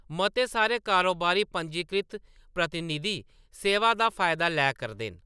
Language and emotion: Dogri, neutral